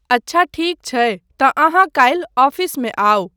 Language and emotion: Maithili, neutral